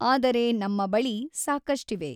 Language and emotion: Kannada, neutral